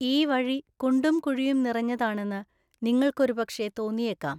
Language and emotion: Malayalam, neutral